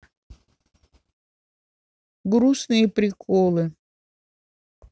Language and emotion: Russian, neutral